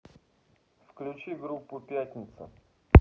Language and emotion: Russian, neutral